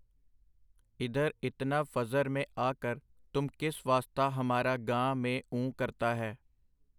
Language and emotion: Punjabi, neutral